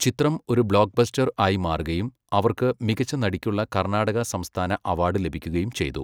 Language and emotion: Malayalam, neutral